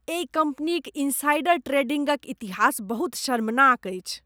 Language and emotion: Maithili, disgusted